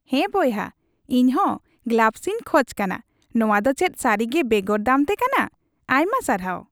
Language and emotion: Santali, happy